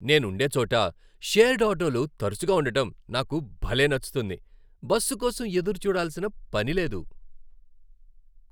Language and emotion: Telugu, happy